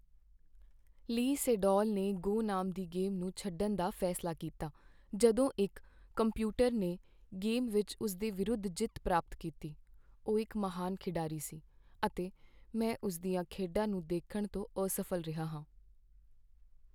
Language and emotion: Punjabi, sad